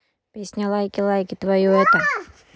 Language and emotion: Russian, neutral